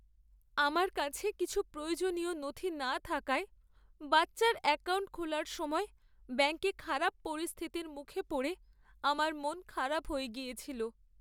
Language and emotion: Bengali, sad